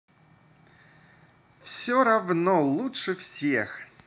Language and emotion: Russian, positive